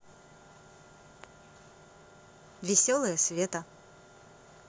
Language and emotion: Russian, positive